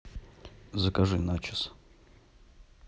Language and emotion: Russian, neutral